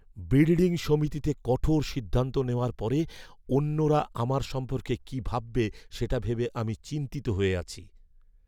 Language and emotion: Bengali, fearful